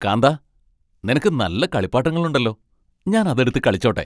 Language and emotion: Malayalam, happy